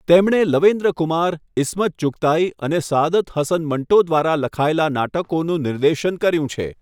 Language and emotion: Gujarati, neutral